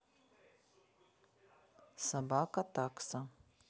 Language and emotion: Russian, neutral